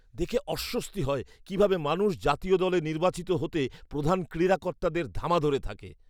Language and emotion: Bengali, disgusted